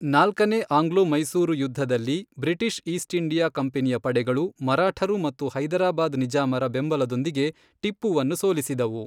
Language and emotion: Kannada, neutral